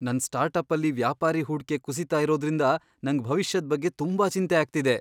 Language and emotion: Kannada, fearful